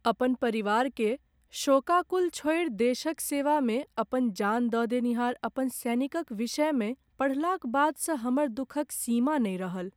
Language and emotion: Maithili, sad